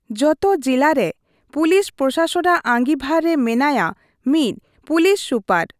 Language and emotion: Santali, neutral